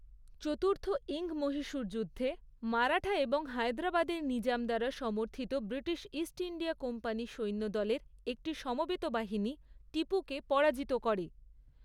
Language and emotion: Bengali, neutral